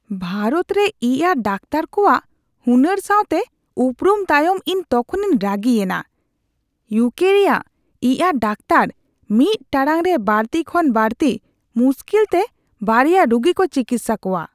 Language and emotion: Santali, disgusted